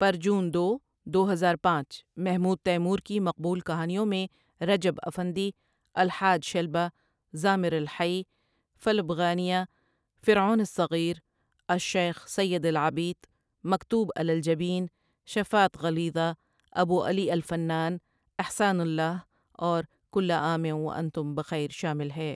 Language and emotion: Urdu, neutral